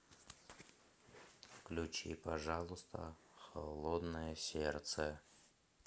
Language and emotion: Russian, neutral